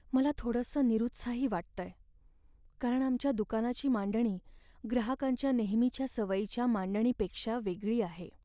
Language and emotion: Marathi, sad